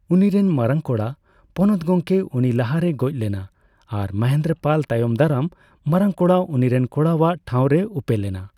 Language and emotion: Santali, neutral